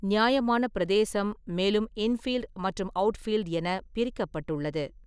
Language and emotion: Tamil, neutral